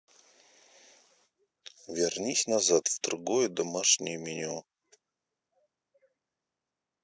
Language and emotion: Russian, neutral